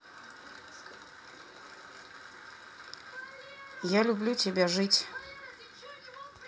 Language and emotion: Russian, neutral